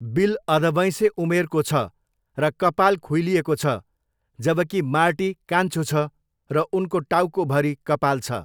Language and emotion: Nepali, neutral